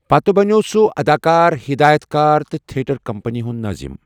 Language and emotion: Kashmiri, neutral